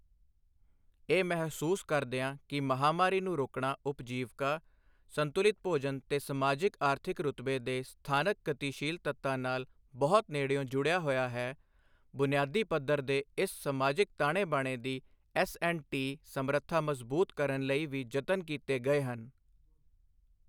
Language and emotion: Punjabi, neutral